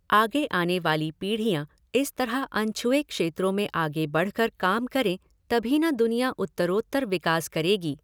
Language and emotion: Hindi, neutral